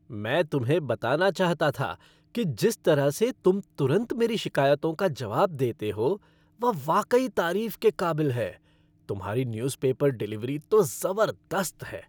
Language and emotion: Hindi, happy